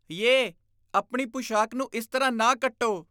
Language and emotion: Punjabi, disgusted